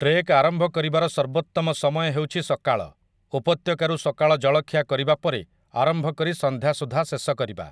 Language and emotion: Odia, neutral